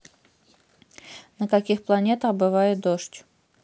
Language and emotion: Russian, neutral